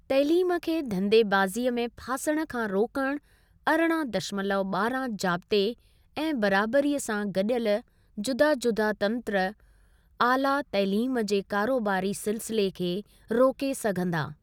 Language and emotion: Sindhi, neutral